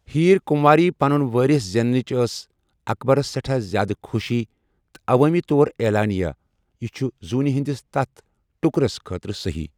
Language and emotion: Kashmiri, neutral